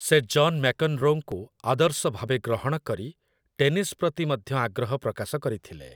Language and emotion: Odia, neutral